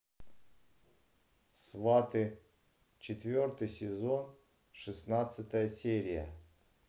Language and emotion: Russian, neutral